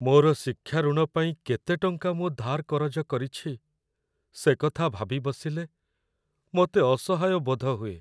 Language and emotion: Odia, sad